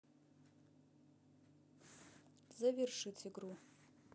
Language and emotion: Russian, neutral